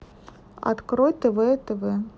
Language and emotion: Russian, neutral